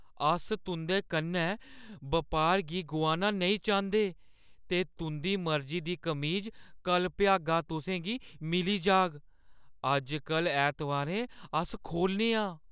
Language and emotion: Dogri, fearful